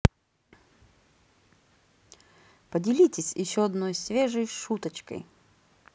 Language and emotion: Russian, positive